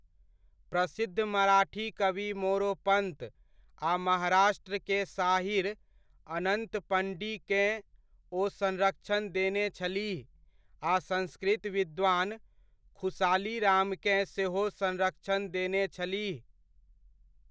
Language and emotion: Maithili, neutral